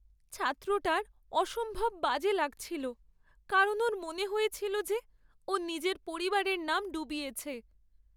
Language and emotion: Bengali, sad